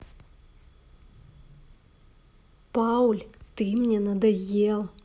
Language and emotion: Russian, angry